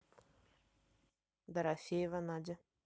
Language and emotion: Russian, neutral